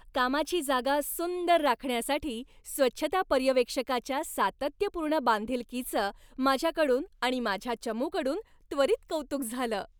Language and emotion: Marathi, happy